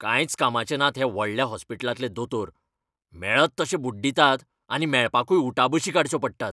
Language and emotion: Goan Konkani, angry